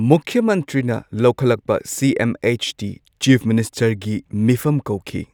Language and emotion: Manipuri, neutral